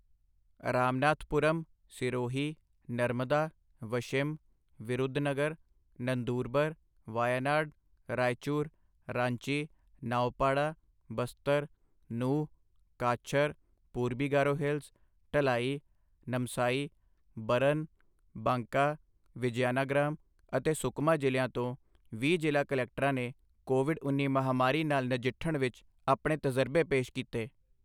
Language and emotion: Punjabi, neutral